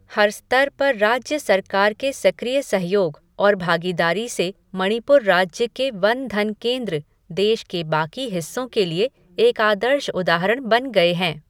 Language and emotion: Hindi, neutral